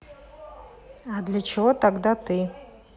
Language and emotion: Russian, neutral